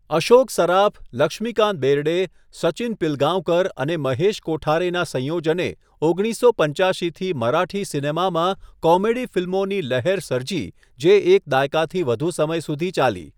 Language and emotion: Gujarati, neutral